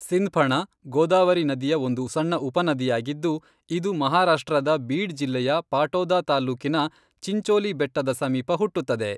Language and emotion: Kannada, neutral